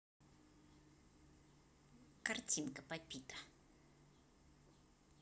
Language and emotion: Russian, positive